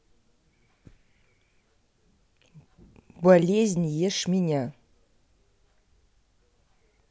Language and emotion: Russian, neutral